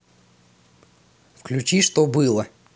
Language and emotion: Russian, neutral